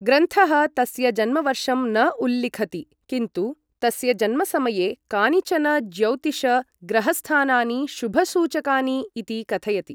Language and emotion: Sanskrit, neutral